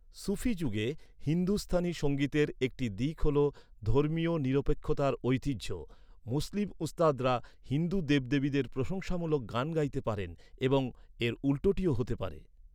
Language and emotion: Bengali, neutral